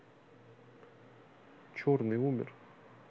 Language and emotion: Russian, neutral